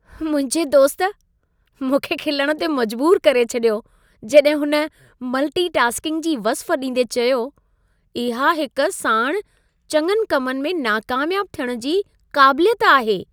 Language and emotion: Sindhi, happy